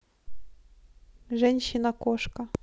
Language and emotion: Russian, neutral